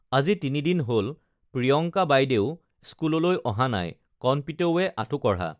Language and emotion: Assamese, neutral